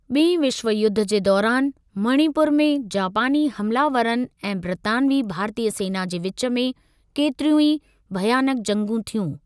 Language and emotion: Sindhi, neutral